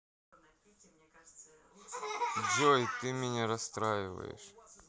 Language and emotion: Russian, neutral